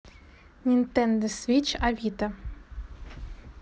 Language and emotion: Russian, neutral